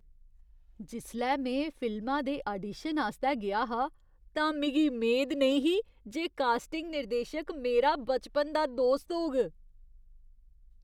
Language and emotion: Dogri, surprised